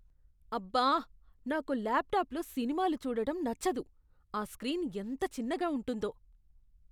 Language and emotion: Telugu, disgusted